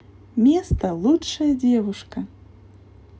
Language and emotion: Russian, positive